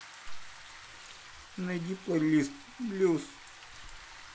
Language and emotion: Russian, neutral